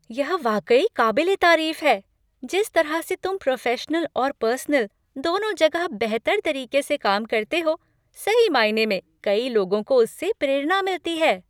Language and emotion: Hindi, happy